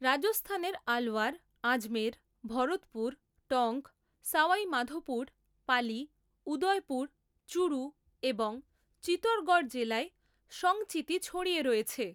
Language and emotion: Bengali, neutral